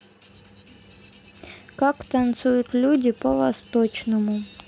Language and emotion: Russian, neutral